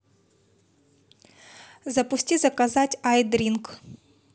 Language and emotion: Russian, neutral